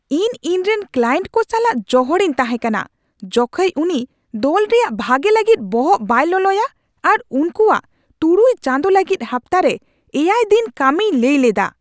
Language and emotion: Santali, angry